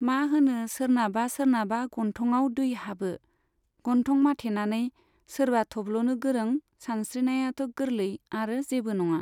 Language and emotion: Bodo, neutral